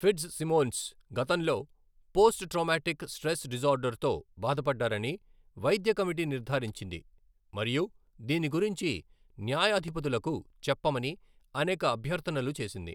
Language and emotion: Telugu, neutral